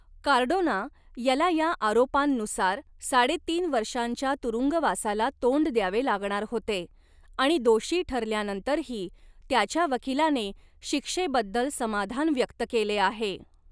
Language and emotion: Marathi, neutral